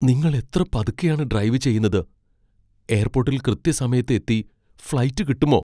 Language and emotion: Malayalam, fearful